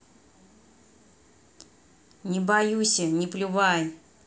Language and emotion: Russian, neutral